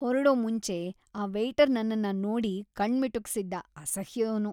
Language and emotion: Kannada, disgusted